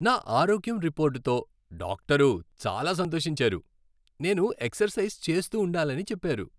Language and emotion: Telugu, happy